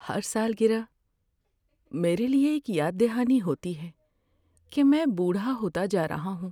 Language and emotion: Urdu, sad